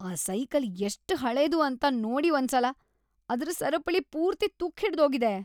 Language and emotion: Kannada, disgusted